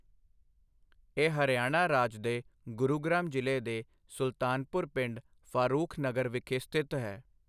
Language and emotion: Punjabi, neutral